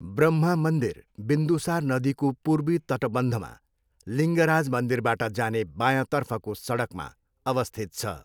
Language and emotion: Nepali, neutral